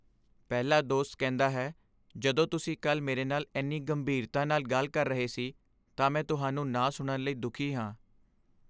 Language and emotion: Punjabi, sad